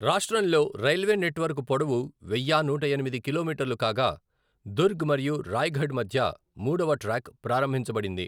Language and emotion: Telugu, neutral